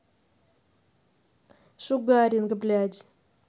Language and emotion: Russian, angry